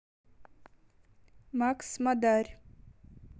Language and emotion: Russian, neutral